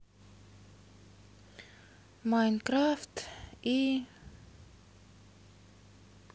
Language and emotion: Russian, sad